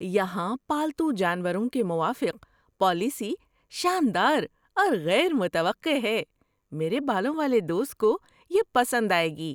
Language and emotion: Urdu, surprised